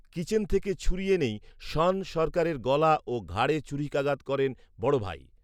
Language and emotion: Bengali, neutral